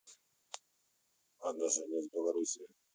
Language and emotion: Russian, neutral